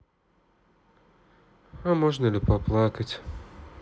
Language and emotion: Russian, sad